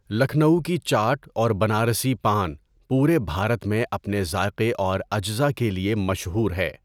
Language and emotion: Urdu, neutral